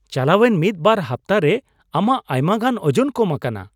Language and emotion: Santali, surprised